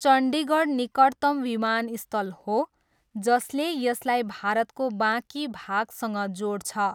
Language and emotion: Nepali, neutral